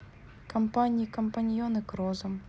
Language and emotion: Russian, neutral